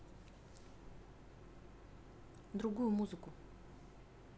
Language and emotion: Russian, neutral